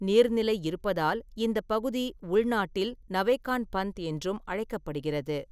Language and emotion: Tamil, neutral